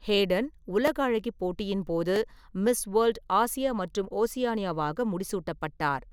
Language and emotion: Tamil, neutral